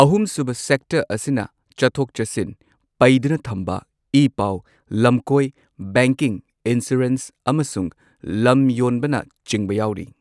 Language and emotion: Manipuri, neutral